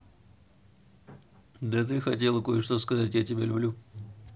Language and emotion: Russian, neutral